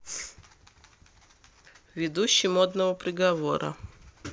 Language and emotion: Russian, neutral